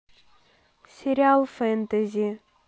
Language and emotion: Russian, neutral